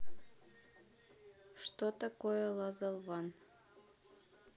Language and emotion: Russian, neutral